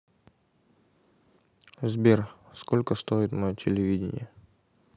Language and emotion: Russian, neutral